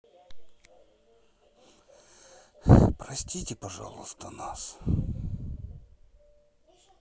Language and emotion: Russian, sad